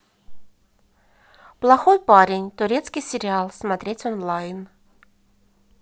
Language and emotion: Russian, neutral